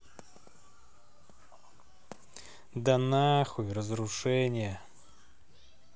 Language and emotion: Russian, angry